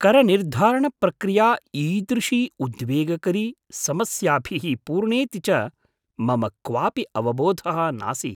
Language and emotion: Sanskrit, surprised